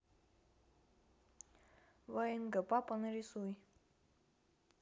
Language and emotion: Russian, neutral